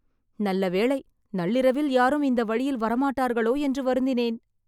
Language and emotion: Tamil, happy